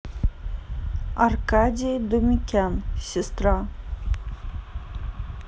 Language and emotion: Russian, neutral